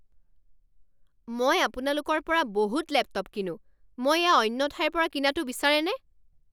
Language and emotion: Assamese, angry